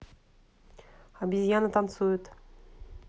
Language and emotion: Russian, neutral